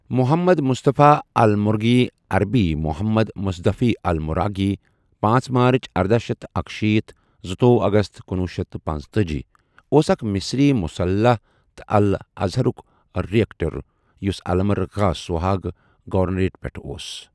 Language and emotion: Kashmiri, neutral